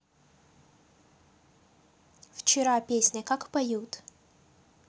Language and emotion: Russian, neutral